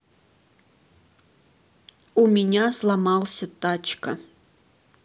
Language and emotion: Russian, neutral